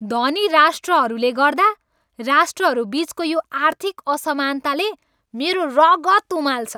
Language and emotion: Nepali, angry